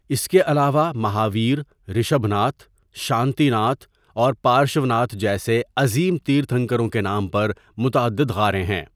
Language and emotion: Urdu, neutral